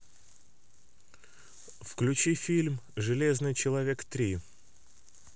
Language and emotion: Russian, neutral